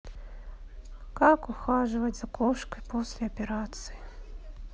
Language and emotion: Russian, sad